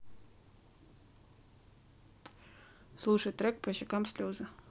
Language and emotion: Russian, neutral